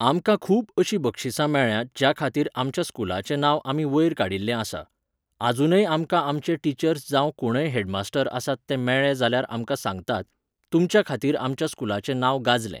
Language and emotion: Goan Konkani, neutral